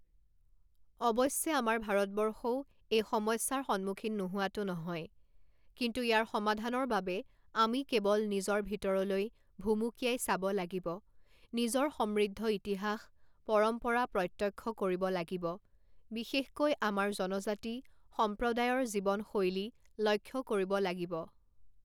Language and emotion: Assamese, neutral